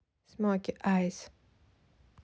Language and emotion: Russian, neutral